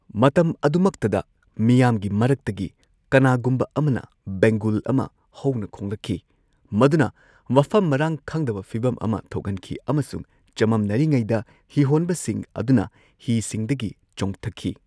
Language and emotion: Manipuri, neutral